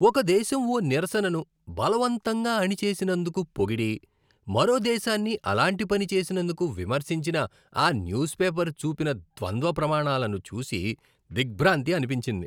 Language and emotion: Telugu, disgusted